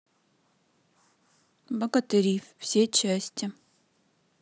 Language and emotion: Russian, neutral